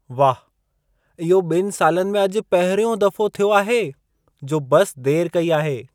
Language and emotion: Sindhi, surprised